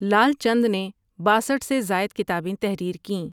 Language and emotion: Urdu, neutral